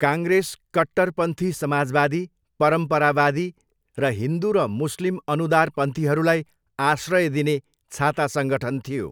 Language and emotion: Nepali, neutral